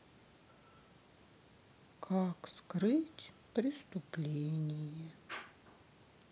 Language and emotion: Russian, sad